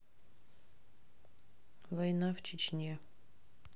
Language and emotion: Russian, neutral